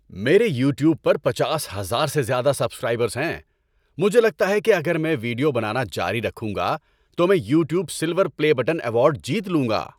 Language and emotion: Urdu, happy